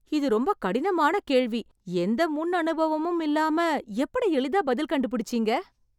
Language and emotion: Tamil, surprised